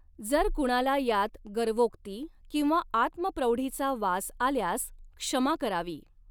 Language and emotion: Marathi, neutral